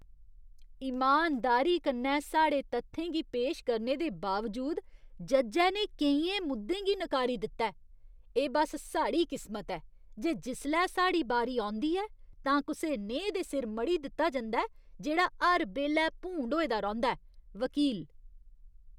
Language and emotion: Dogri, disgusted